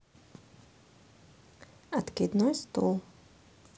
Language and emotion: Russian, neutral